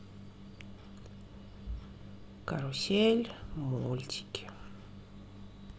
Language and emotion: Russian, sad